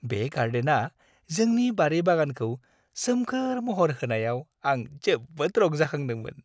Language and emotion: Bodo, happy